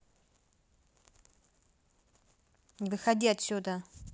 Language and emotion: Russian, angry